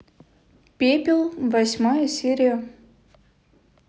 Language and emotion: Russian, neutral